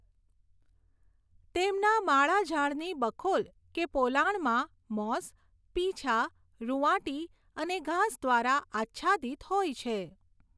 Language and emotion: Gujarati, neutral